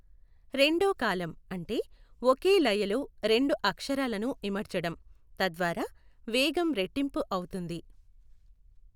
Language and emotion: Telugu, neutral